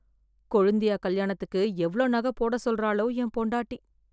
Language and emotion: Tamil, fearful